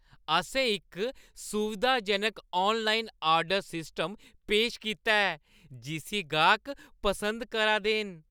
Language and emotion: Dogri, happy